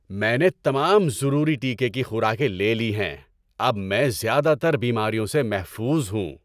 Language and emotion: Urdu, happy